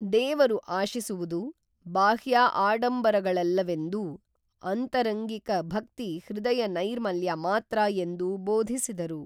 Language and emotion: Kannada, neutral